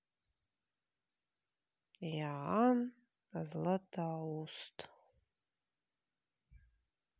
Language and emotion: Russian, neutral